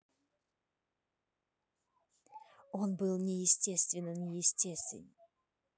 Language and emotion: Russian, neutral